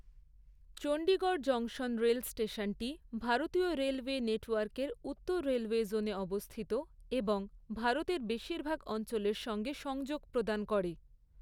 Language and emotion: Bengali, neutral